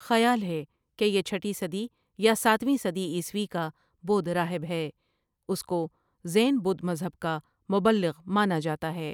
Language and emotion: Urdu, neutral